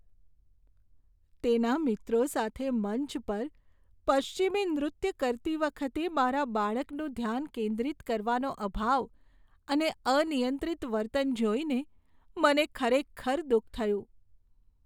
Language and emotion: Gujarati, sad